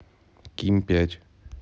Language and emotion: Russian, neutral